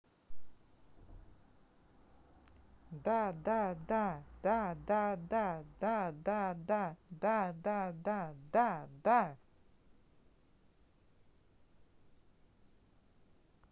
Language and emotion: Russian, positive